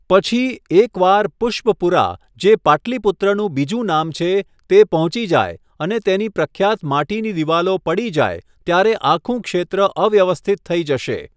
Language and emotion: Gujarati, neutral